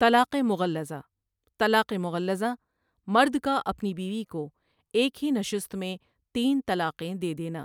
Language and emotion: Urdu, neutral